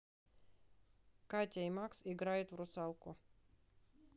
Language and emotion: Russian, neutral